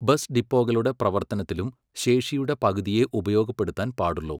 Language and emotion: Malayalam, neutral